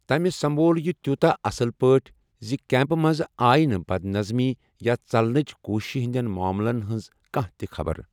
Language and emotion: Kashmiri, neutral